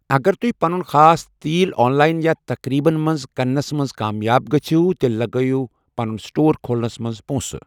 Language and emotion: Kashmiri, neutral